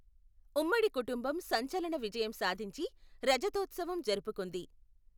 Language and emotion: Telugu, neutral